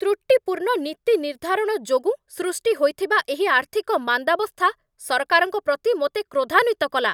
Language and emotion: Odia, angry